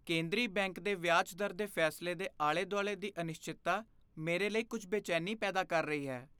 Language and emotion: Punjabi, fearful